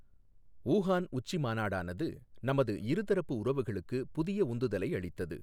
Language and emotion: Tamil, neutral